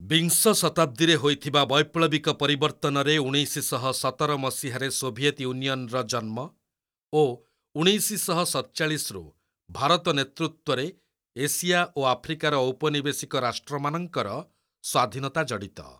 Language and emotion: Odia, neutral